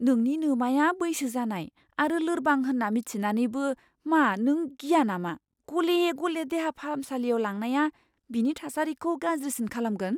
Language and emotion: Bodo, fearful